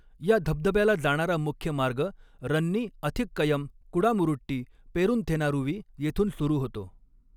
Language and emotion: Marathi, neutral